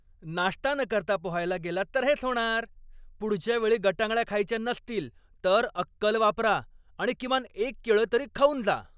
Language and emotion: Marathi, angry